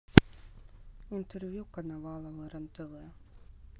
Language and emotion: Russian, sad